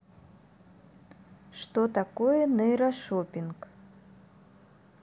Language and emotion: Russian, neutral